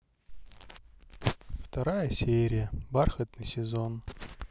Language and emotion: Russian, sad